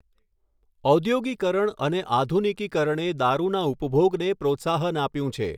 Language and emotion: Gujarati, neutral